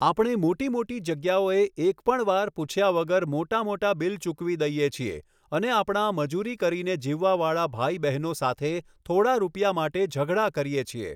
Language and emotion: Gujarati, neutral